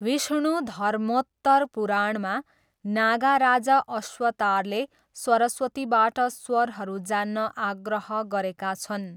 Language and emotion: Nepali, neutral